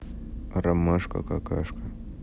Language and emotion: Russian, neutral